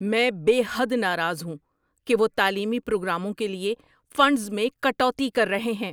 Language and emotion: Urdu, angry